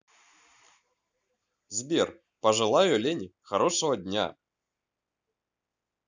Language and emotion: Russian, positive